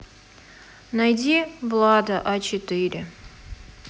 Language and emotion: Russian, sad